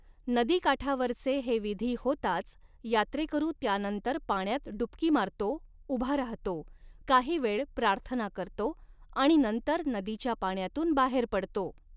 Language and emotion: Marathi, neutral